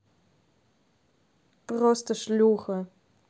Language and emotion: Russian, angry